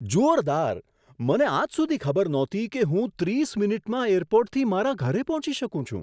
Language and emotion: Gujarati, surprised